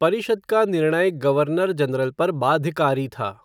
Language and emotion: Hindi, neutral